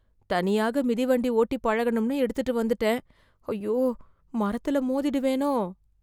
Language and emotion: Tamil, fearful